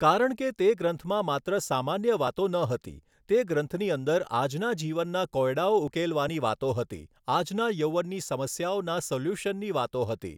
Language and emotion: Gujarati, neutral